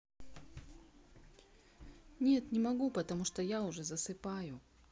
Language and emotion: Russian, neutral